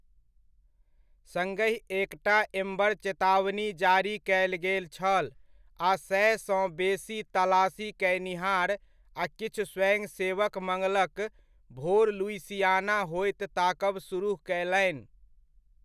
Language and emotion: Maithili, neutral